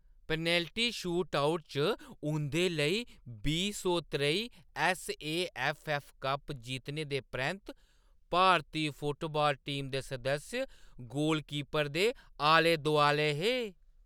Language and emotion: Dogri, happy